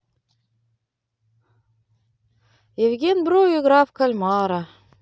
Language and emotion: Russian, positive